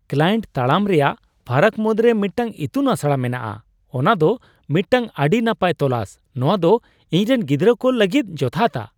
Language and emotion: Santali, surprised